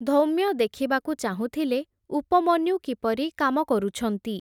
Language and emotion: Odia, neutral